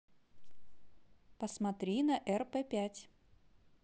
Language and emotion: Russian, positive